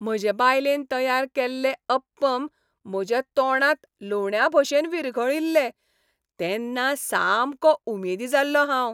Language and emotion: Goan Konkani, happy